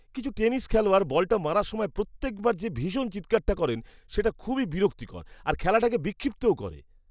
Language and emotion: Bengali, disgusted